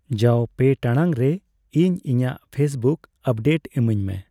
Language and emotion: Santali, neutral